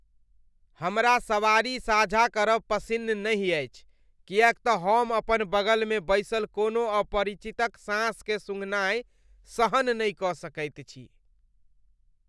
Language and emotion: Maithili, disgusted